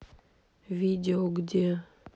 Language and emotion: Russian, neutral